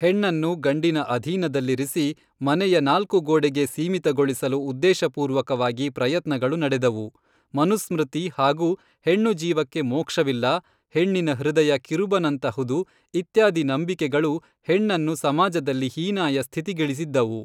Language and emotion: Kannada, neutral